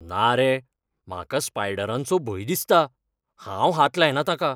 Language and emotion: Goan Konkani, fearful